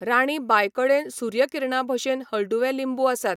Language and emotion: Goan Konkani, neutral